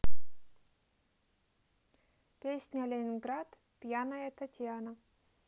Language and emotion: Russian, neutral